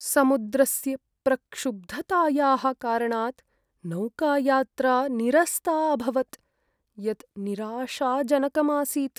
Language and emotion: Sanskrit, sad